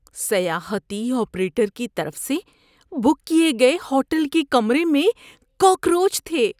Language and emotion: Urdu, disgusted